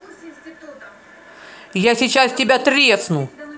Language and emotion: Russian, angry